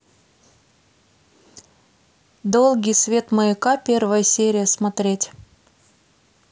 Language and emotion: Russian, neutral